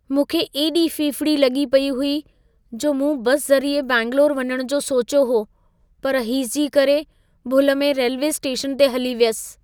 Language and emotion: Sindhi, fearful